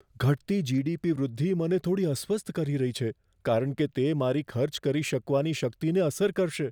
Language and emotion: Gujarati, fearful